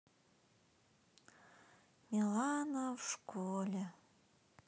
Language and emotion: Russian, sad